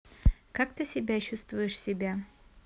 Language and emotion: Russian, neutral